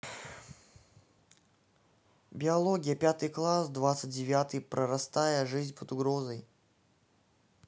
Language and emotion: Russian, neutral